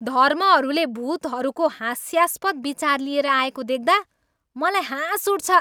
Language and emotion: Nepali, angry